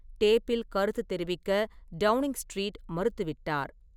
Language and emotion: Tamil, neutral